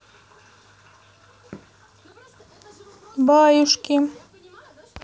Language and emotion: Russian, neutral